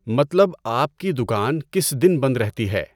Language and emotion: Urdu, neutral